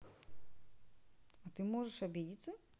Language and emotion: Russian, neutral